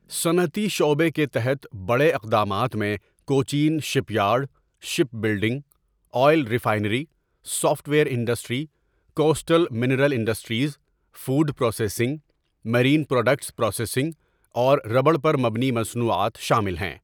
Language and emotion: Urdu, neutral